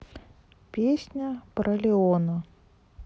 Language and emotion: Russian, neutral